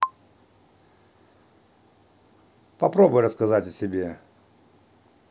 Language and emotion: Russian, neutral